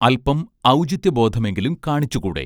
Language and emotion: Malayalam, neutral